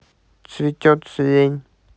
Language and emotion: Russian, neutral